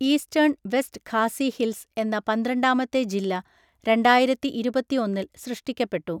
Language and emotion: Malayalam, neutral